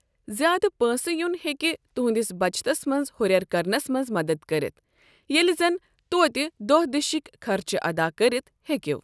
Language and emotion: Kashmiri, neutral